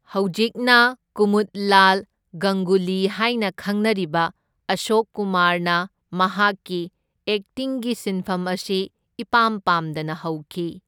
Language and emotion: Manipuri, neutral